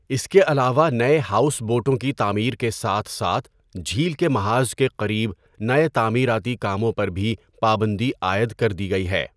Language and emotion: Urdu, neutral